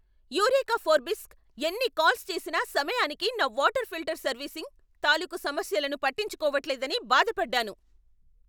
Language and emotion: Telugu, angry